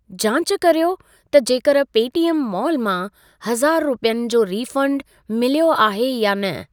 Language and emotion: Sindhi, neutral